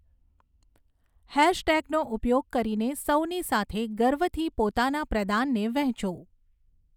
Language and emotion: Gujarati, neutral